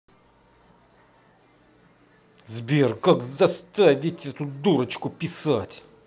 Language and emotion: Russian, angry